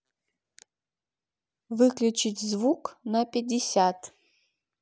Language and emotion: Russian, neutral